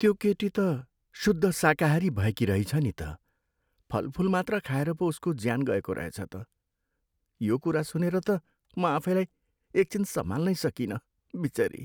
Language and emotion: Nepali, sad